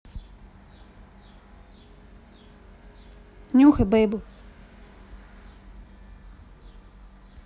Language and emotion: Russian, neutral